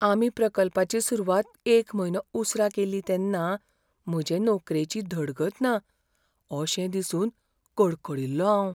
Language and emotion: Goan Konkani, fearful